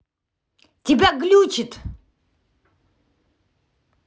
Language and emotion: Russian, angry